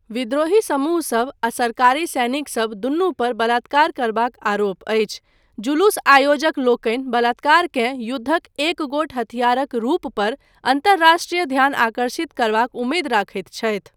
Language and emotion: Maithili, neutral